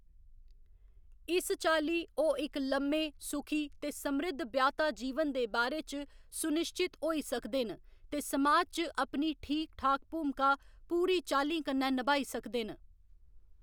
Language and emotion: Dogri, neutral